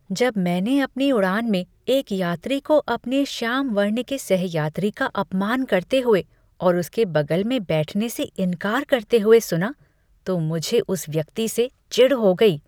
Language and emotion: Hindi, disgusted